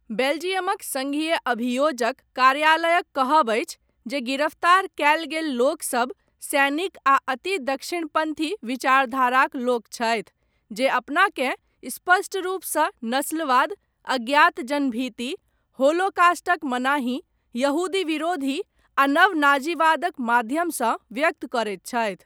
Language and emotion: Maithili, neutral